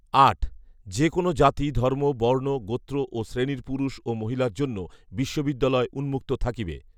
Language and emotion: Bengali, neutral